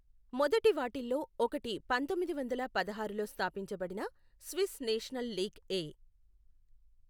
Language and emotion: Telugu, neutral